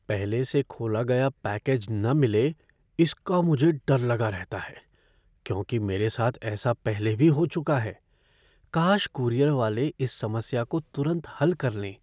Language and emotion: Hindi, fearful